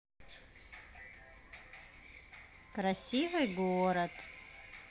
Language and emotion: Russian, positive